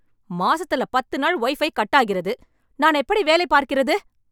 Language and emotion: Tamil, angry